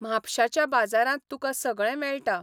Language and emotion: Goan Konkani, neutral